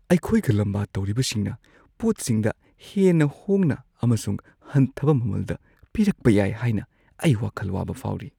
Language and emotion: Manipuri, fearful